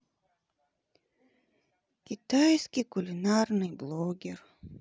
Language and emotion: Russian, sad